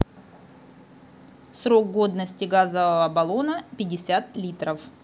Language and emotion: Russian, neutral